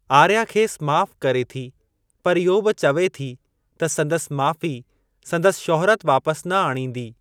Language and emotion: Sindhi, neutral